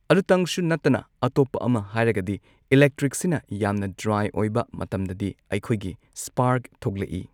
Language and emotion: Manipuri, neutral